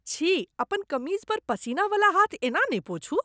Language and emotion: Maithili, disgusted